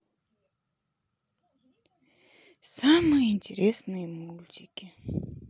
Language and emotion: Russian, sad